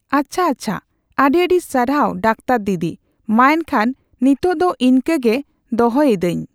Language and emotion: Santali, neutral